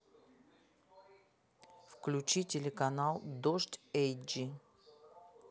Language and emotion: Russian, neutral